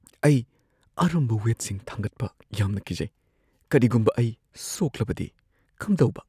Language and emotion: Manipuri, fearful